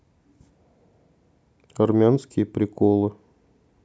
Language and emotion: Russian, neutral